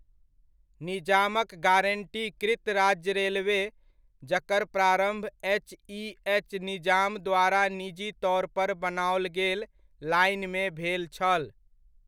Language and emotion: Maithili, neutral